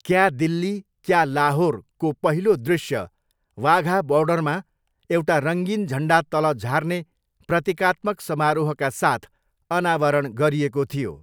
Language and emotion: Nepali, neutral